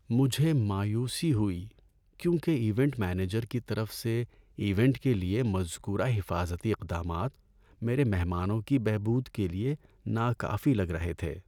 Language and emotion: Urdu, sad